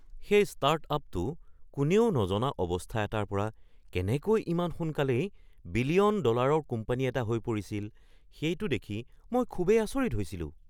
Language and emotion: Assamese, surprised